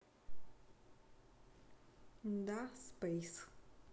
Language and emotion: Russian, neutral